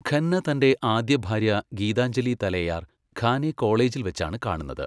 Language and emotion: Malayalam, neutral